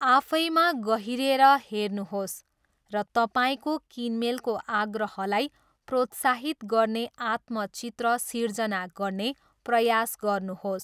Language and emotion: Nepali, neutral